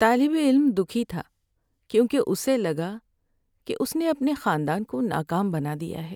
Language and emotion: Urdu, sad